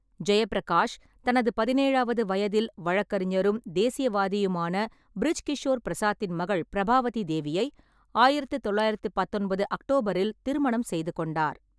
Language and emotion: Tamil, neutral